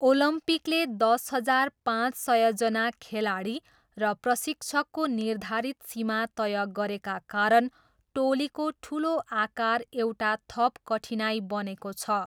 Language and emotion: Nepali, neutral